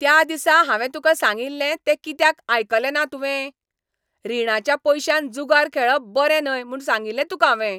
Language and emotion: Goan Konkani, angry